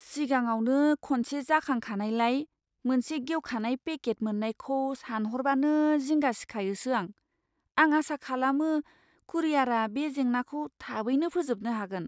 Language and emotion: Bodo, fearful